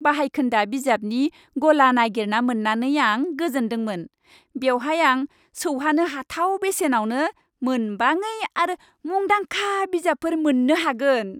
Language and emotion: Bodo, happy